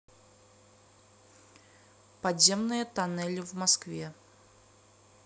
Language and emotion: Russian, neutral